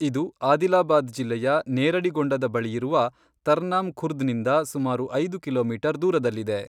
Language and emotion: Kannada, neutral